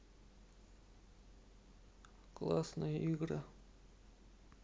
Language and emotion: Russian, sad